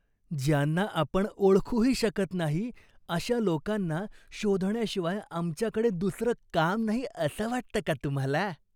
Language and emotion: Marathi, disgusted